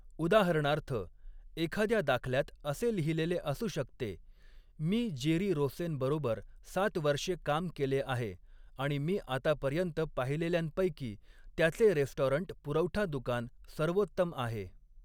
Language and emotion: Marathi, neutral